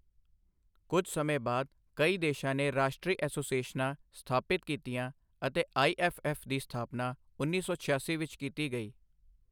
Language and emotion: Punjabi, neutral